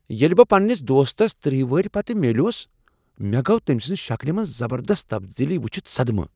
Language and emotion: Kashmiri, surprised